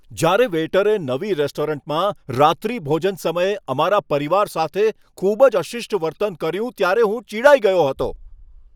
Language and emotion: Gujarati, angry